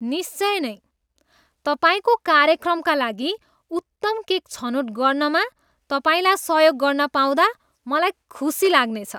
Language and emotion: Nepali, disgusted